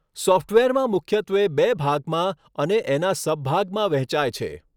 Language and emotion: Gujarati, neutral